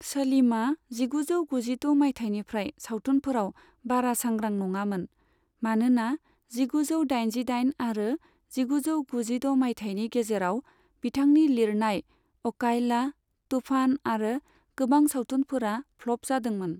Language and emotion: Bodo, neutral